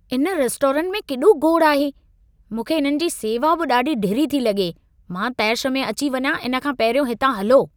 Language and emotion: Sindhi, angry